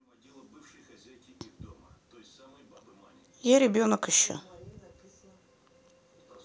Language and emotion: Russian, neutral